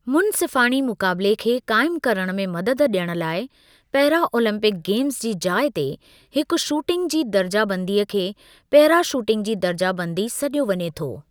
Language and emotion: Sindhi, neutral